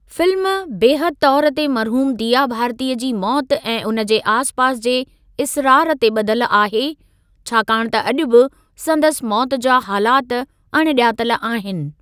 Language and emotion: Sindhi, neutral